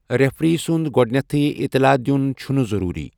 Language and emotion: Kashmiri, neutral